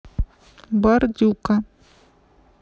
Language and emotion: Russian, neutral